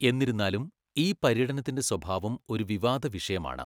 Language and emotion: Malayalam, neutral